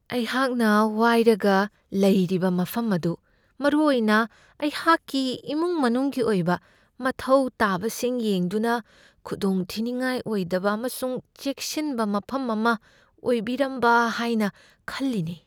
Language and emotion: Manipuri, fearful